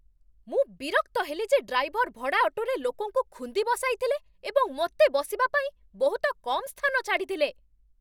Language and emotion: Odia, angry